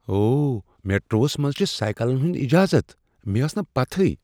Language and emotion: Kashmiri, surprised